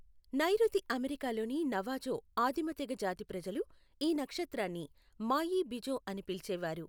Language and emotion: Telugu, neutral